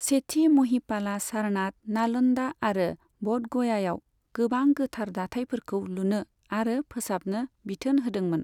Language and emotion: Bodo, neutral